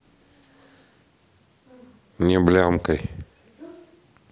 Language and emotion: Russian, neutral